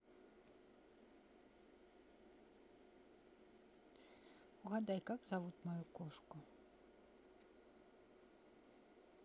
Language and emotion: Russian, neutral